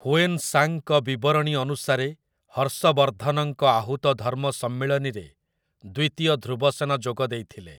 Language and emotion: Odia, neutral